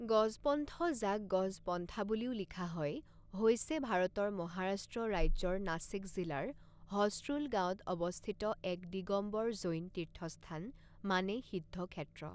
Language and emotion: Assamese, neutral